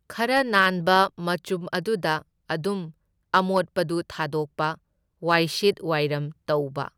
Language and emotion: Manipuri, neutral